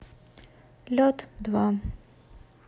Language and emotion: Russian, neutral